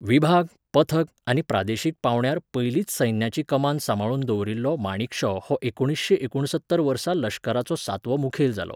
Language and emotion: Goan Konkani, neutral